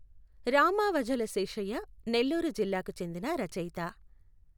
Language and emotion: Telugu, neutral